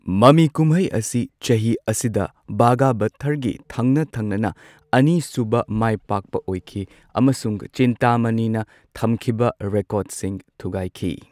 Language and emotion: Manipuri, neutral